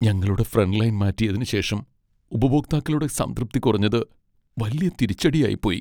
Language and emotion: Malayalam, sad